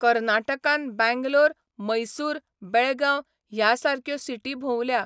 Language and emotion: Goan Konkani, neutral